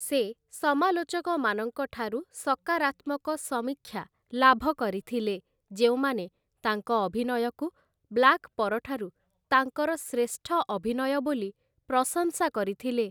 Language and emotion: Odia, neutral